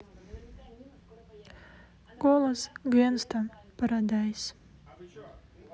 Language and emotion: Russian, sad